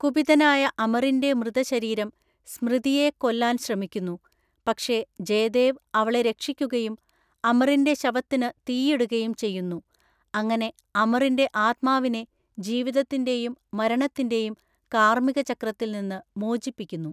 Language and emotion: Malayalam, neutral